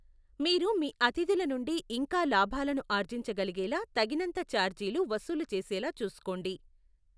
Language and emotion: Telugu, neutral